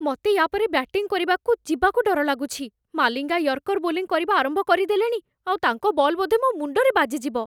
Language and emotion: Odia, fearful